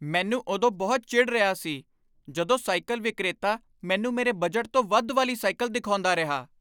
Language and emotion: Punjabi, angry